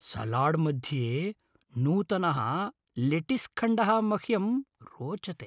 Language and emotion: Sanskrit, happy